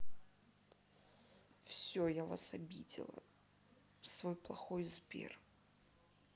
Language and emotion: Russian, sad